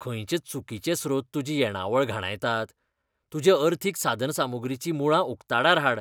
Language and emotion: Goan Konkani, disgusted